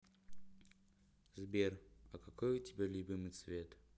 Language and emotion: Russian, neutral